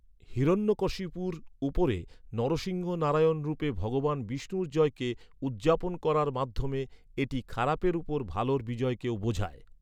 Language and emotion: Bengali, neutral